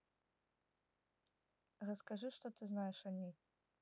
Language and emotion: Russian, neutral